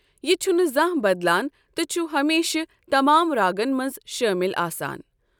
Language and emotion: Kashmiri, neutral